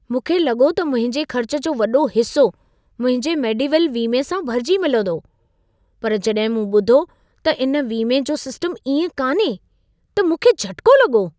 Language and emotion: Sindhi, surprised